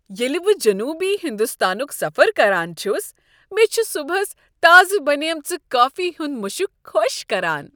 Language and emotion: Kashmiri, happy